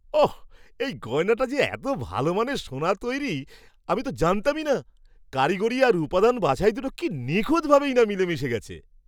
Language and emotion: Bengali, surprised